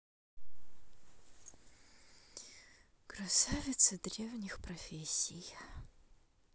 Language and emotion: Russian, sad